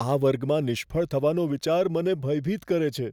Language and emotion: Gujarati, fearful